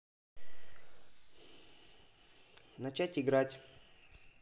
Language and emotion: Russian, neutral